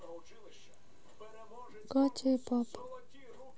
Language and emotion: Russian, sad